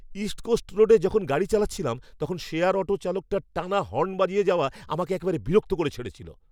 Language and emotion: Bengali, angry